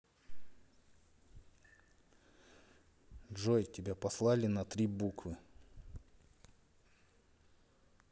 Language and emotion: Russian, neutral